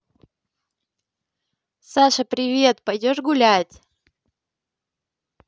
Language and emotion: Russian, positive